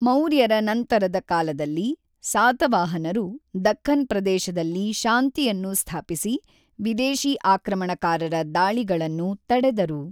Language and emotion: Kannada, neutral